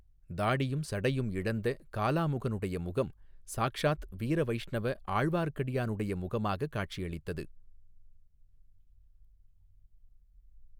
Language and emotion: Tamil, neutral